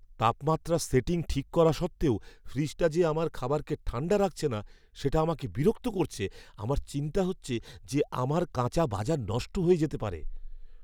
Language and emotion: Bengali, fearful